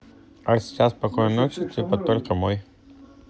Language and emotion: Russian, neutral